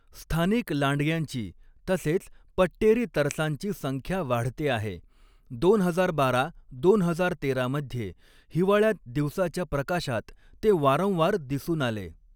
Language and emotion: Marathi, neutral